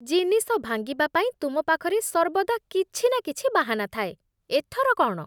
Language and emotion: Odia, disgusted